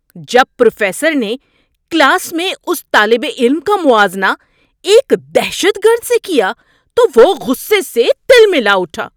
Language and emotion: Urdu, angry